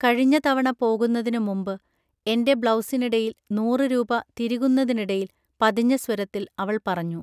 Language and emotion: Malayalam, neutral